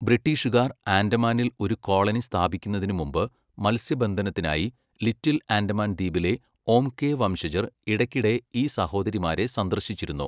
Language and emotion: Malayalam, neutral